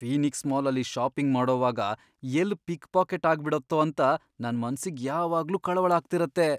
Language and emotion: Kannada, fearful